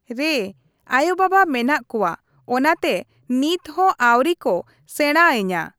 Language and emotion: Santali, neutral